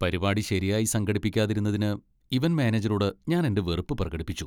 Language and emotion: Malayalam, disgusted